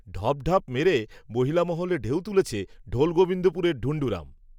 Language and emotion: Bengali, neutral